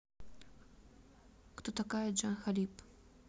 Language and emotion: Russian, neutral